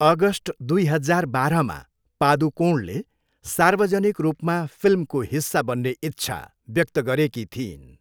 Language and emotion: Nepali, neutral